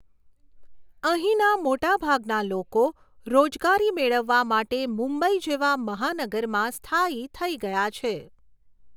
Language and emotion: Gujarati, neutral